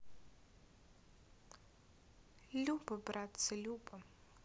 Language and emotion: Russian, sad